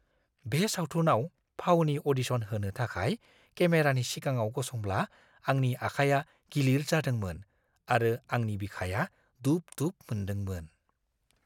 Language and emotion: Bodo, fearful